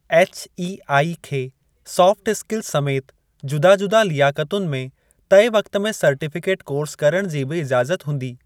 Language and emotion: Sindhi, neutral